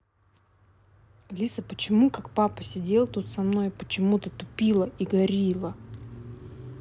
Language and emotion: Russian, angry